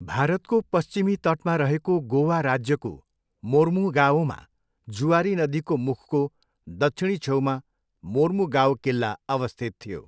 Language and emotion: Nepali, neutral